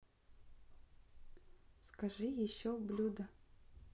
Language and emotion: Russian, neutral